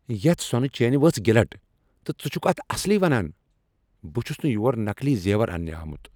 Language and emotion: Kashmiri, angry